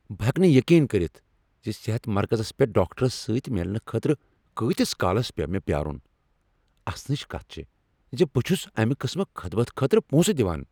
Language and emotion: Kashmiri, angry